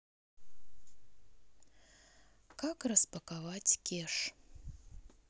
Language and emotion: Russian, sad